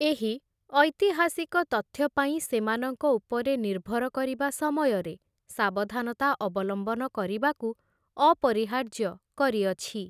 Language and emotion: Odia, neutral